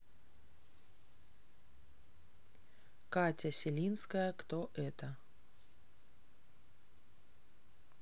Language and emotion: Russian, neutral